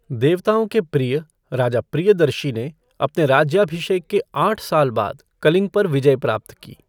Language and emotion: Hindi, neutral